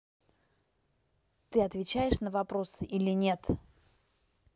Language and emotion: Russian, angry